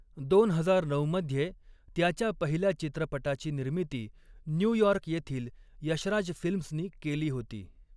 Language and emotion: Marathi, neutral